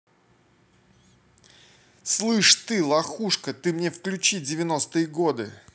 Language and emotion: Russian, angry